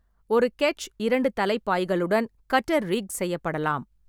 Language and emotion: Tamil, neutral